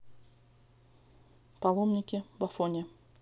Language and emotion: Russian, neutral